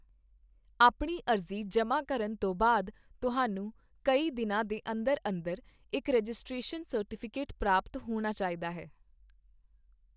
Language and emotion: Punjabi, neutral